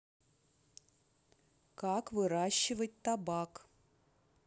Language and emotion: Russian, neutral